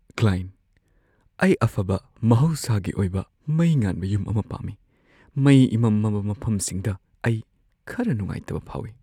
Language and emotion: Manipuri, fearful